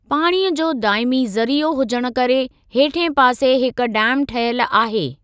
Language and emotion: Sindhi, neutral